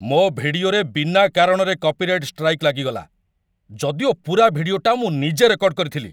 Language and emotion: Odia, angry